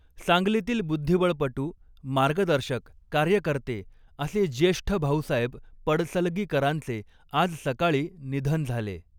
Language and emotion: Marathi, neutral